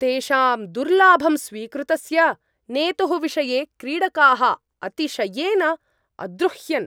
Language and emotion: Sanskrit, angry